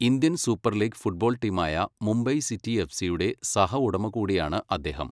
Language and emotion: Malayalam, neutral